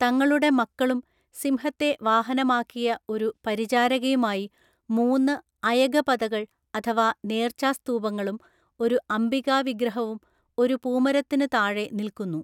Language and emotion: Malayalam, neutral